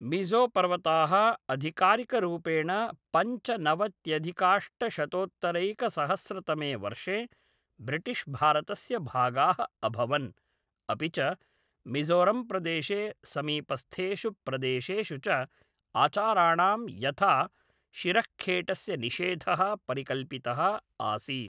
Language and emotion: Sanskrit, neutral